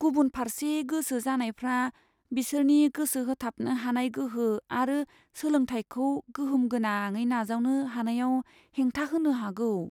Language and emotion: Bodo, fearful